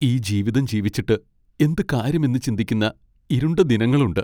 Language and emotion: Malayalam, sad